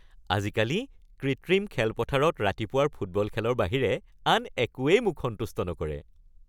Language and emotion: Assamese, happy